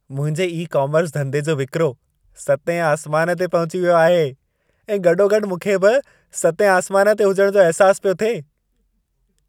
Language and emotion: Sindhi, happy